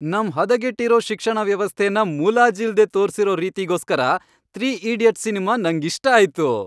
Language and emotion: Kannada, happy